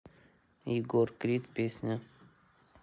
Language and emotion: Russian, neutral